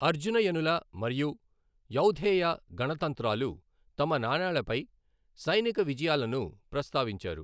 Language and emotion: Telugu, neutral